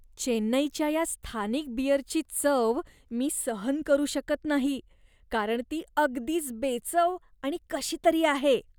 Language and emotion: Marathi, disgusted